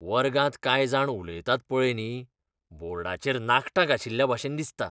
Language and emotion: Goan Konkani, disgusted